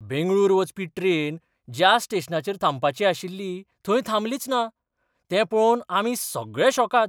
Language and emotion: Goan Konkani, surprised